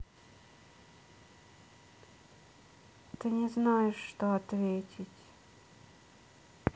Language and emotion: Russian, sad